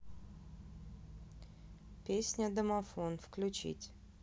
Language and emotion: Russian, neutral